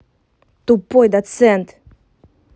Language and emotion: Russian, angry